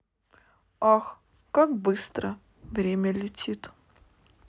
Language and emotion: Russian, neutral